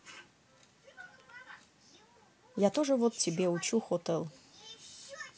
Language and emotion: Russian, neutral